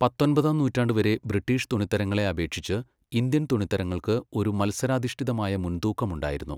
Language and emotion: Malayalam, neutral